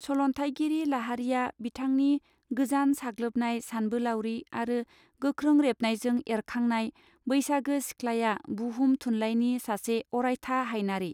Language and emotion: Bodo, neutral